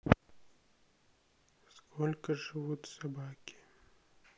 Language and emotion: Russian, sad